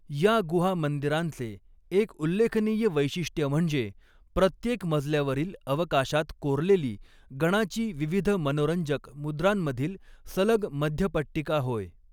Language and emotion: Marathi, neutral